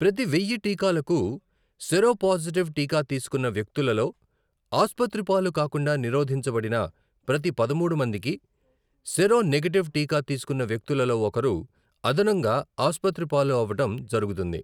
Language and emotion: Telugu, neutral